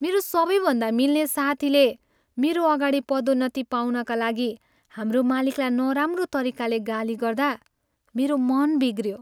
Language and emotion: Nepali, sad